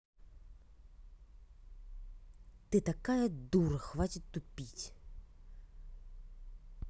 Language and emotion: Russian, angry